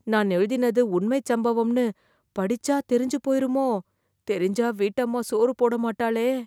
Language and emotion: Tamil, fearful